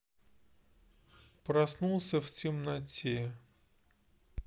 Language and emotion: Russian, neutral